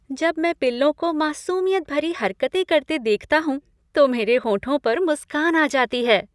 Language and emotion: Hindi, happy